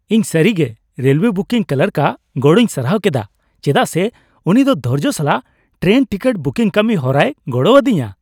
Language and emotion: Santali, happy